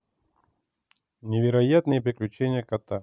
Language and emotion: Russian, neutral